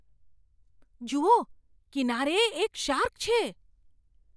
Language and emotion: Gujarati, surprised